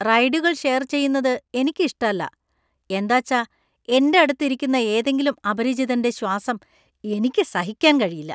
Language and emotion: Malayalam, disgusted